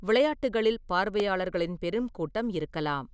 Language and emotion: Tamil, neutral